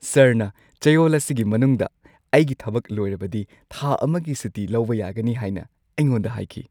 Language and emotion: Manipuri, happy